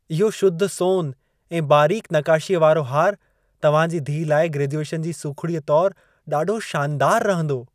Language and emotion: Sindhi, happy